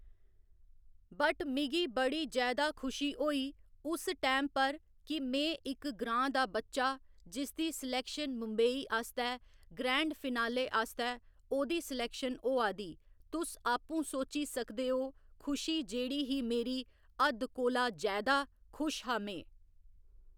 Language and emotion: Dogri, neutral